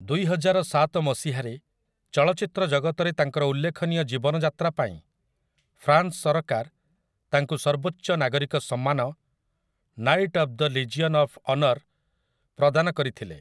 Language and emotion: Odia, neutral